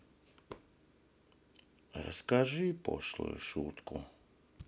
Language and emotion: Russian, sad